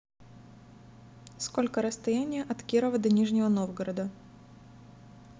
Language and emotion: Russian, neutral